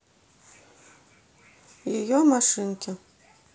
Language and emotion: Russian, neutral